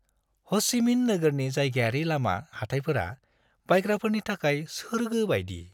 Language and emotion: Bodo, happy